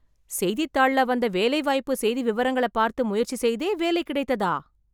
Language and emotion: Tamil, surprised